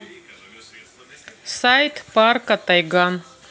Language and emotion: Russian, neutral